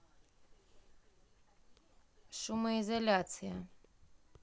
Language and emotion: Russian, neutral